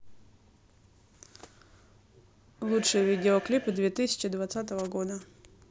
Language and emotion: Russian, neutral